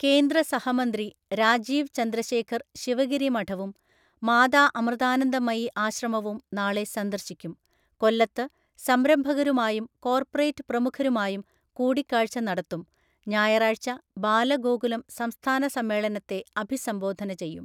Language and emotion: Malayalam, neutral